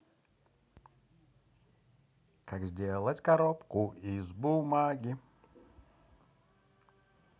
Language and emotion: Russian, positive